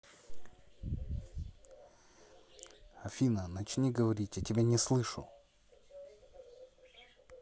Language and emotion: Russian, neutral